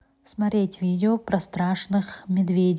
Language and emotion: Russian, neutral